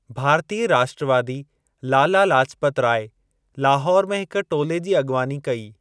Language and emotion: Sindhi, neutral